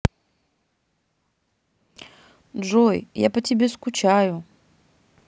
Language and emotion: Russian, sad